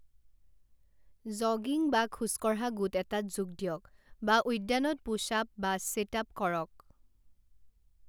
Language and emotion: Assamese, neutral